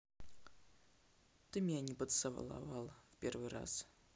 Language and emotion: Russian, sad